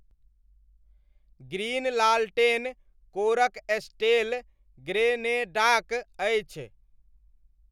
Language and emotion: Maithili, neutral